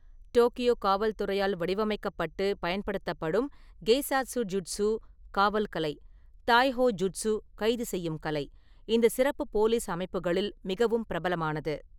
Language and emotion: Tamil, neutral